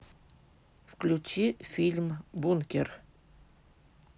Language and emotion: Russian, neutral